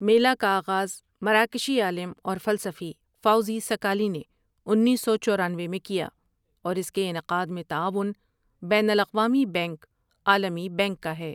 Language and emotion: Urdu, neutral